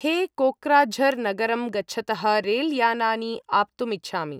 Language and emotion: Sanskrit, neutral